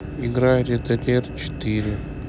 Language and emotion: Russian, sad